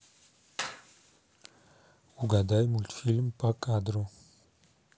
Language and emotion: Russian, neutral